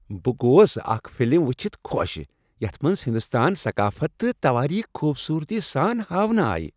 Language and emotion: Kashmiri, happy